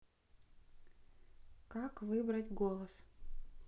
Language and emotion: Russian, neutral